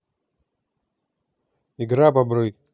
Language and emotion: Russian, neutral